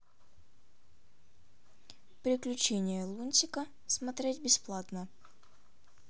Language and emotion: Russian, neutral